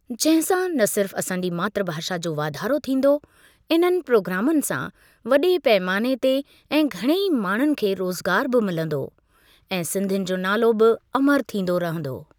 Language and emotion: Sindhi, neutral